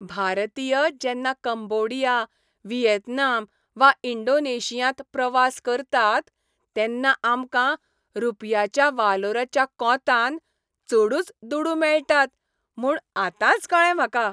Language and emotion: Goan Konkani, happy